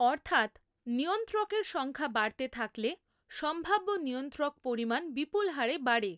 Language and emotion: Bengali, neutral